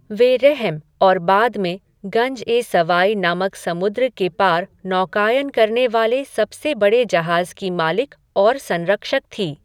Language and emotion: Hindi, neutral